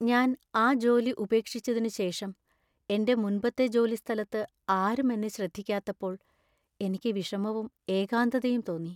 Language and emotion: Malayalam, sad